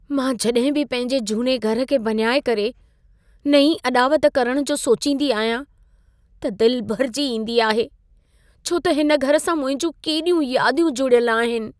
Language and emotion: Sindhi, sad